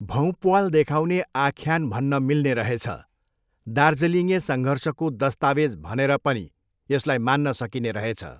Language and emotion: Nepali, neutral